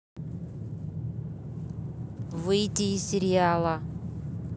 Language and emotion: Russian, angry